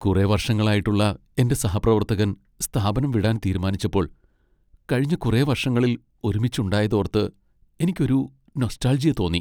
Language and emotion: Malayalam, sad